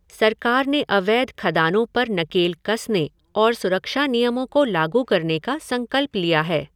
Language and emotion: Hindi, neutral